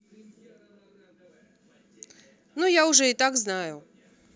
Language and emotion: Russian, neutral